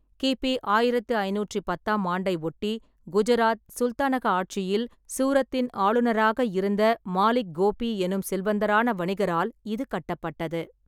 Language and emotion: Tamil, neutral